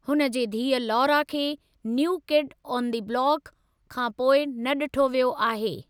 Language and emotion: Sindhi, neutral